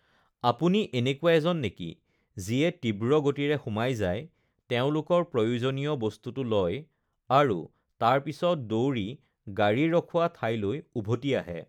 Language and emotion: Assamese, neutral